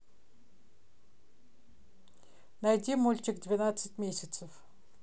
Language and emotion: Russian, neutral